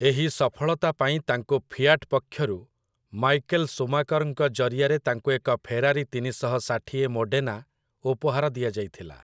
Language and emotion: Odia, neutral